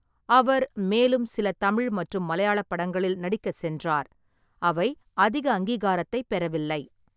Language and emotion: Tamil, neutral